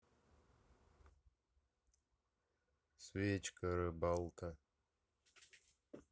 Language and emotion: Russian, neutral